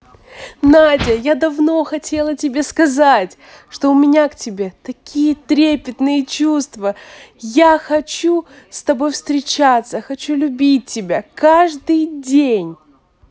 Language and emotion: Russian, positive